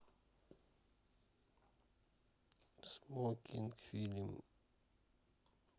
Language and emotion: Russian, neutral